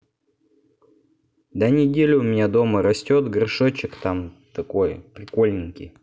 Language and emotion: Russian, neutral